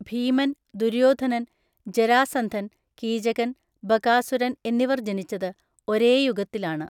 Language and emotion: Malayalam, neutral